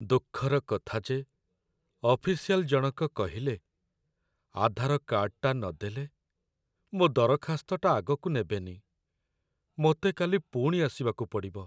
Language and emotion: Odia, sad